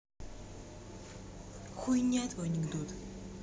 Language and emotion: Russian, angry